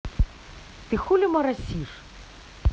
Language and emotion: Russian, angry